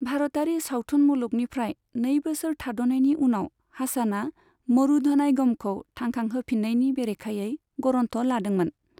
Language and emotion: Bodo, neutral